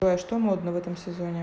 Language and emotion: Russian, neutral